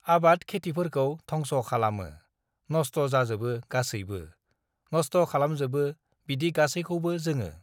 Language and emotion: Bodo, neutral